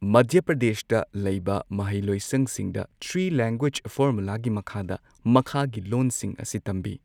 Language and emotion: Manipuri, neutral